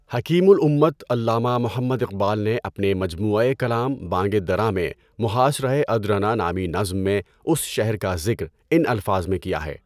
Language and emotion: Urdu, neutral